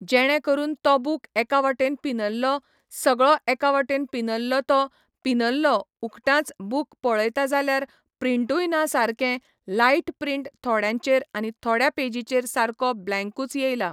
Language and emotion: Goan Konkani, neutral